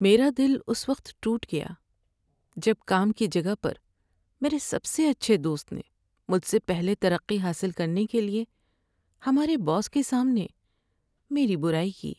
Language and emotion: Urdu, sad